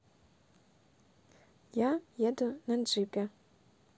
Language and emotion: Russian, neutral